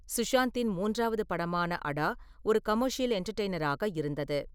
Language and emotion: Tamil, neutral